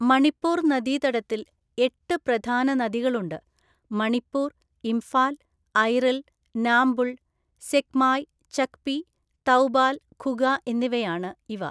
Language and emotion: Malayalam, neutral